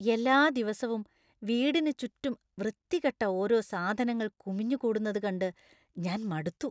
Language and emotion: Malayalam, disgusted